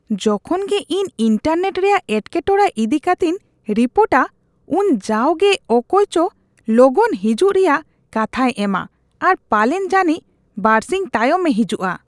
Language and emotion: Santali, disgusted